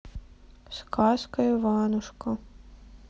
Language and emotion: Russian, sad